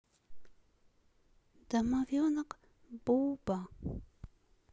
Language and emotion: Russian, sad